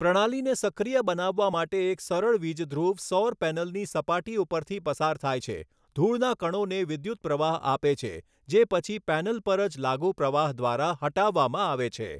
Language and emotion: Gujarati, neutral